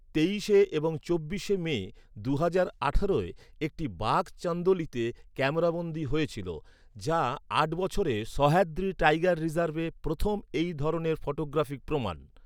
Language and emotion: Bengali, neutral